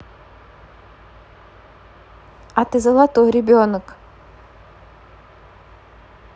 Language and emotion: Russian, neutral